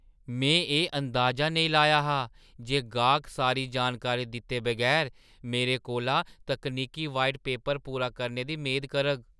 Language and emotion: Dogri, surprised